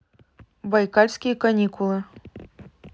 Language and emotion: Russian, neutral